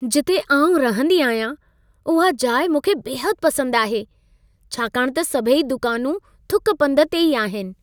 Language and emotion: Sindhi, happy